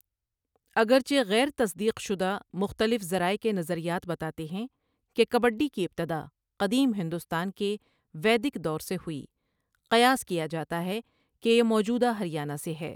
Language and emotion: Urdu, neutral